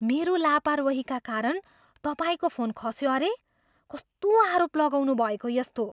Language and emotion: Nepali, surprised